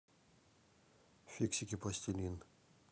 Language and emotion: Russian, neutral